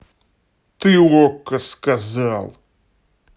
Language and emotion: Russian, angry